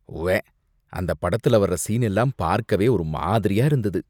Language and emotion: Tamil, disgusted